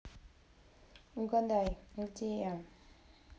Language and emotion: Russian, neutral